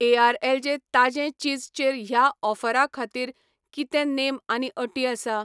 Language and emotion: Goan Konkani, neutral